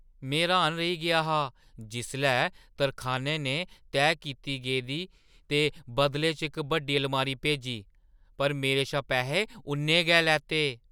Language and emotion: Dogri, surprised